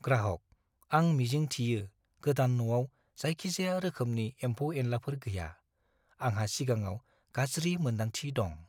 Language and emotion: Bodo, fearful